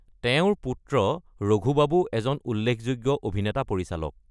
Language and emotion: Assamese, neutral